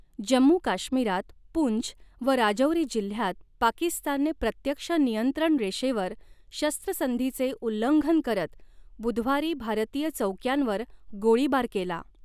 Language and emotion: Marathi, neutral